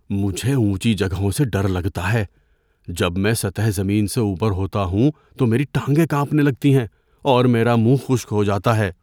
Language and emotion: Urdu, fearful